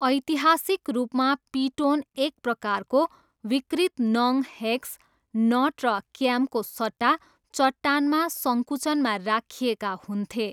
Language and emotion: Nepali, neutral